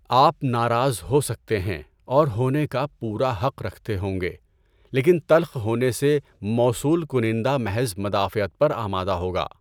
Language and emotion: Urdu, neutral